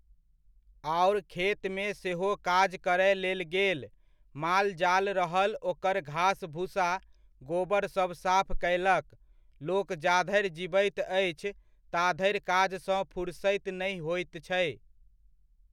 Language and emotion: Maithili, neutral